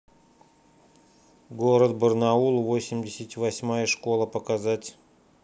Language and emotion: Russian, neutral